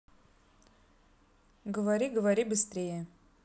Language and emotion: Russian, neutral